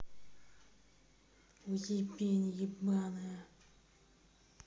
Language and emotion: Russian, angry